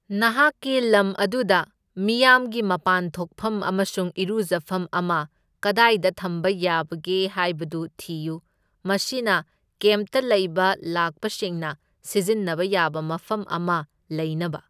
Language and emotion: Manipuri, neutral